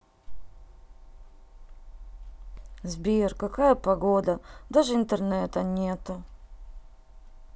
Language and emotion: Russian, sad